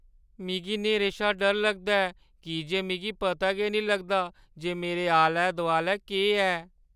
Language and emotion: Dogri, fearful